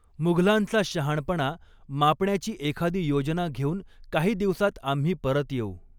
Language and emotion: Marathi, neutral